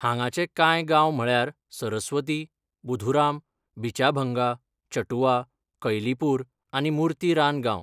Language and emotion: Goan Konkani, neutral